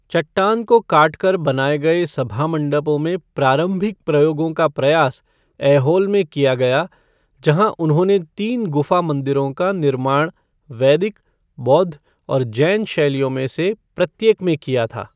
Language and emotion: Hindi, neutral